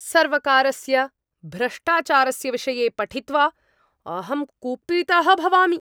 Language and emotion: Sanskrit, angry